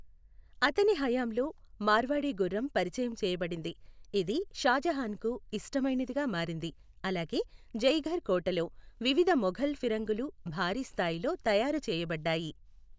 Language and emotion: Telugu, neutral